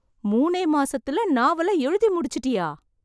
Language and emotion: Tamil, surprised